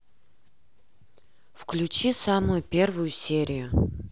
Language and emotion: Russian, neutral